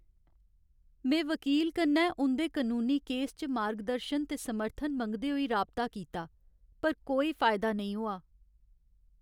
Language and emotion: Dogri, sad